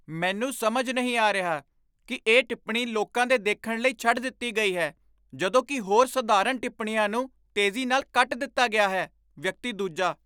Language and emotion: Punjabi, surprised